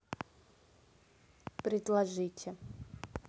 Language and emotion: Russian, neutral